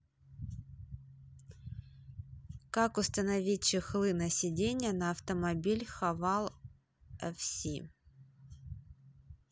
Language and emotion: Russian, neutral